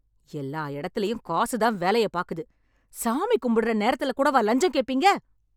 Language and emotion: Tamil, angry